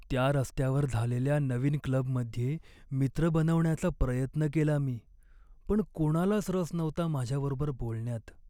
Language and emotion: Marathi, sad